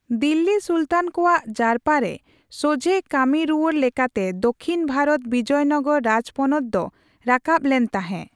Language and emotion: Santali, neutral